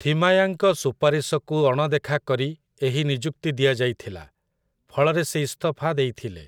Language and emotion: Odia, neutral